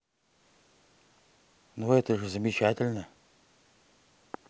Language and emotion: Russian, neutral